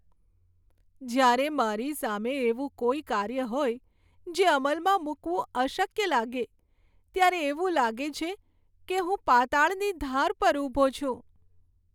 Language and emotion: Gujarati, sad